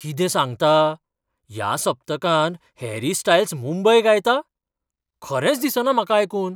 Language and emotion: Goan Konkani, surprised